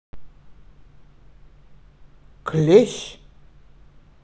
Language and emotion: Russian, neutral